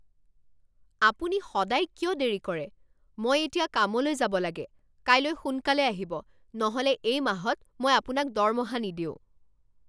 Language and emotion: Assamese, angry